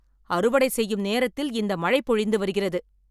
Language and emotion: Tamil, angry